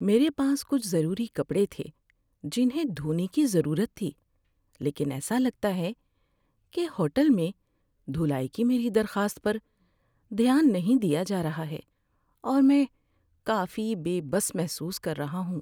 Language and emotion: Urdu, sad